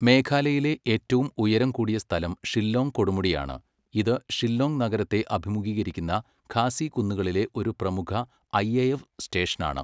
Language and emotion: Malayalam, neutral